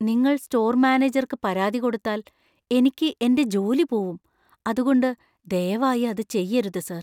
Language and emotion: Malayalam, fearful